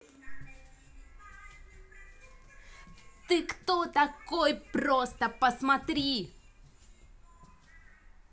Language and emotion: Russian, angry